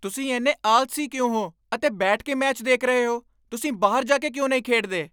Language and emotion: Punjabi, angry